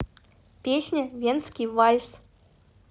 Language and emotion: Russian, neutral